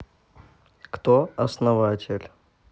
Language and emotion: Russian, neutral